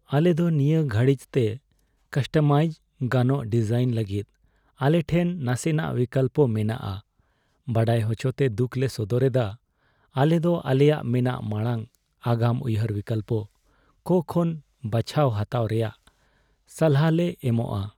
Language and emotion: Santali, sad